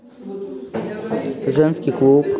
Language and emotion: Russian, neutral